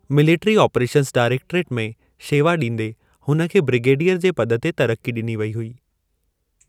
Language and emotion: Sindhi, neutral